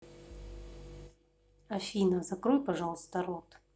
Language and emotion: Russian, neutral